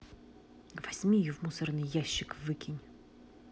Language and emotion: Russian, angry